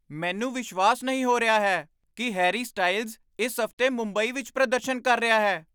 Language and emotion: Punjabi, surprised